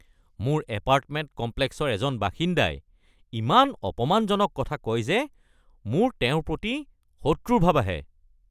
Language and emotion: Assamese, angry